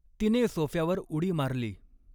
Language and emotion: Marathi, neutral